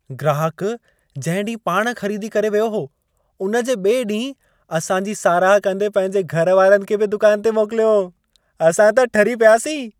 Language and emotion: Sindhi, happy